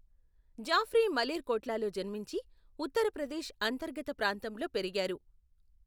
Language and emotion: Telugu, neutral